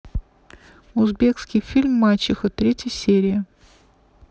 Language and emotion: Russian, neutral